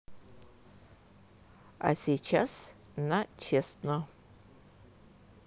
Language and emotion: Russian, neutral